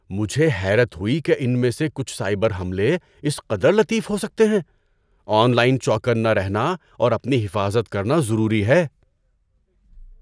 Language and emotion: Urdu, surprised